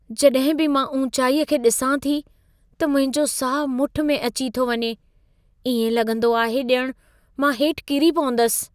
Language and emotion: Sindhi, fearful